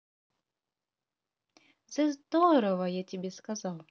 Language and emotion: Russian, positive